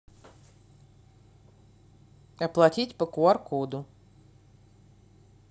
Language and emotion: Russian, neutral